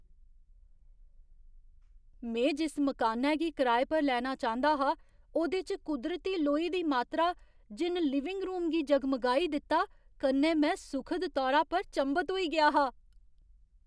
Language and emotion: Dogri, surprised